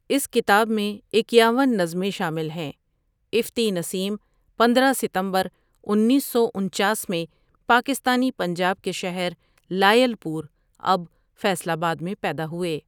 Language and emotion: Urdu, neutral